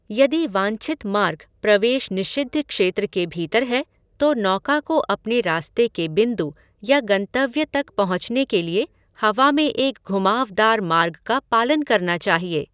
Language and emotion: Hindi, neutral